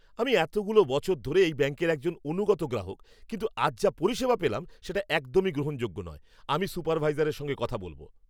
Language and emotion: Bengali, angry